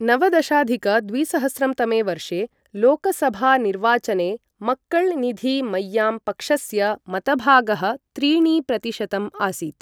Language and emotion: Sanskrit, neutral